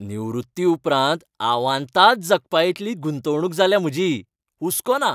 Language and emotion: Goan Konkani, happy